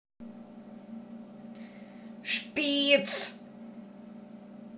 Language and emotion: Russian, angry